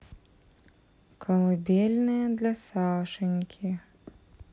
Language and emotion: Russian, neutral